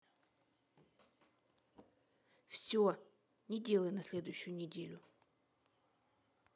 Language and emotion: Russian, neutral